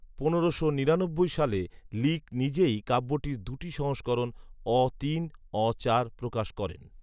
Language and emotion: Bengali, neutral